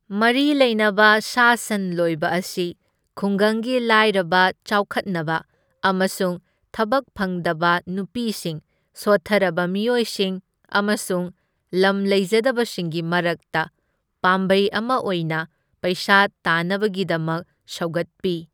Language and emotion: Manipuri, neutral